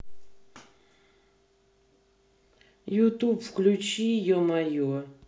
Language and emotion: Russian, neutral